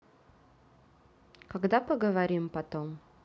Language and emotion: Russian, neutral